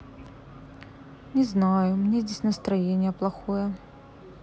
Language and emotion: Russian, sad